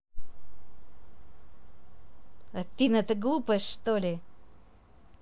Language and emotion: Russian, angry